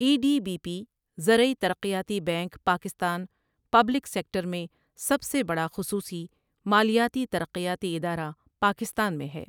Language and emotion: Urdu, neutral